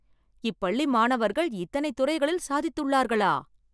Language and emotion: Tamil, surprised